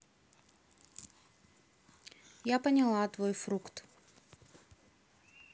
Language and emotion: Russian, neutral